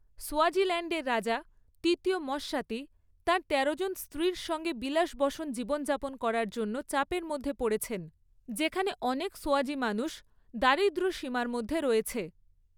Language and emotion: Bengali, neutral